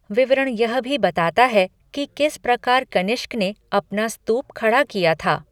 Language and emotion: Hindi, neutral